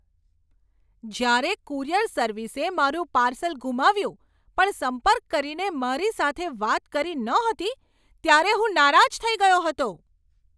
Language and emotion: Gujarati, angry